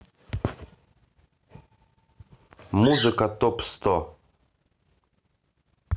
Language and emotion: Russian, neutral